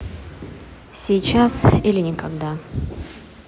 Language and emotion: Russian, neutral